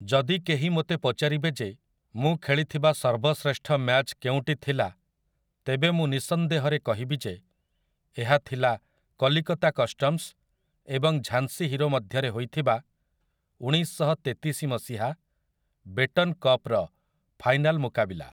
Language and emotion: Odia, neutral